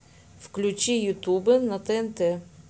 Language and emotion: Russian, neutral